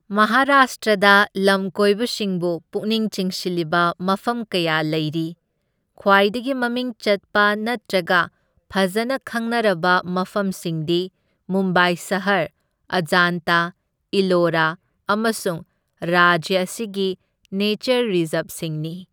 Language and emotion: Manipuri, neutral